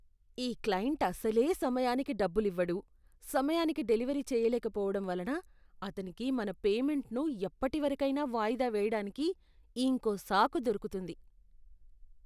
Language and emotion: Telugu, disgusted